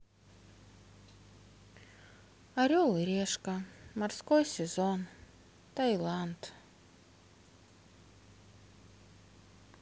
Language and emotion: Russian, sad